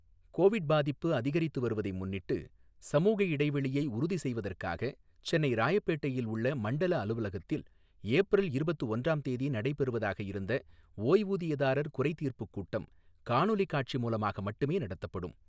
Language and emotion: Tamil, neutral